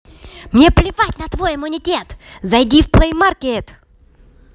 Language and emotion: Russian, angry